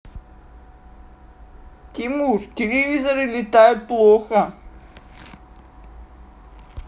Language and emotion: Russian, sad